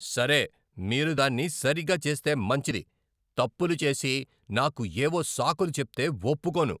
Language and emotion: Telugu, angry